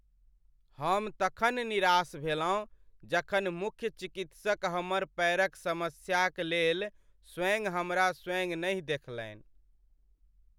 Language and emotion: Maithili, sad